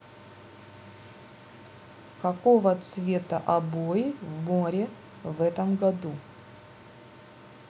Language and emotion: Russian, neutral